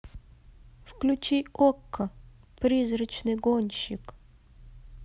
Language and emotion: Russian, neutral